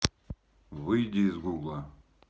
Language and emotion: Russian, neutral